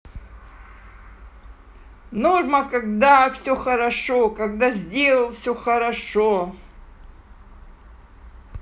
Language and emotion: Russian, positive